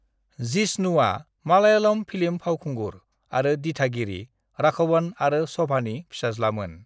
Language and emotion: Bodo, neutral